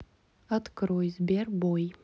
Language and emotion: Russian, neutral